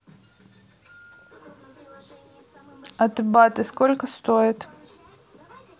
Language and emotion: Russian, neutral